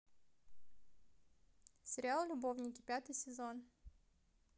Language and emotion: Russian, neutral